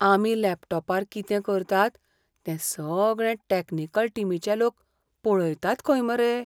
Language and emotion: Goan Konkani, fearful